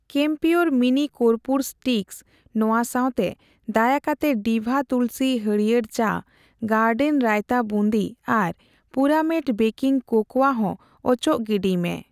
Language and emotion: Santali, neutral